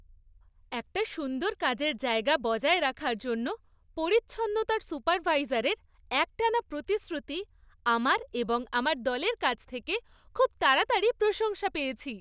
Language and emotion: Bengali, happy